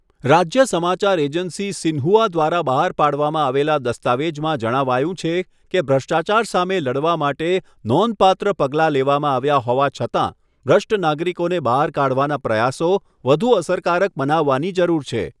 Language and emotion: Gujarati, neutral